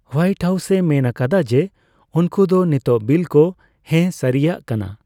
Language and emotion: Santali, neutral